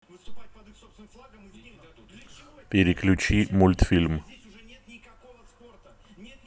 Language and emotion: Russian, neutral